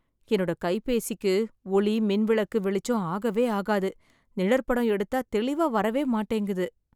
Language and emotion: Tamil, sad